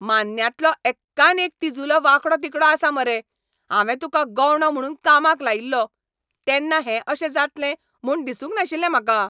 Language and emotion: Goan Konkani, angry